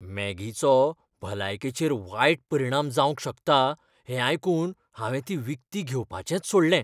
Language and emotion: Goan Konkani, fearful